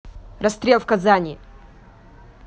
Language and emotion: Russian, angry